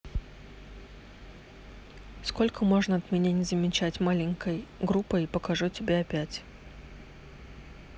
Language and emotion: Russian, neutral